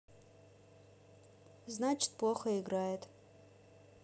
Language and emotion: Russian, neutral